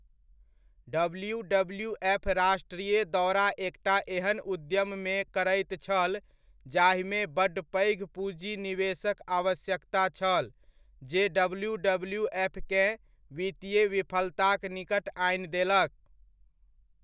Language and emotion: Maithili, neutral